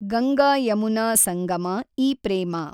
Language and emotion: Kannada, neutral